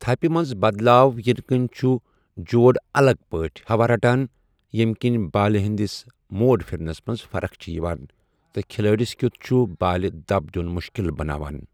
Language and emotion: Kashmiri, neutral